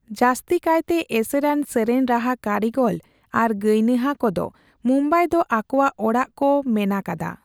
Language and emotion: Santali, neutral